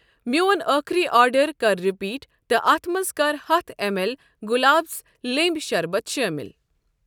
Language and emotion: Kashmiri, neutral